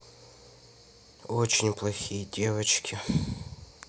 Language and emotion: Russian, sad